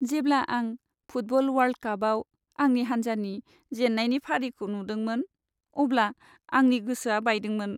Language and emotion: Bodo, sad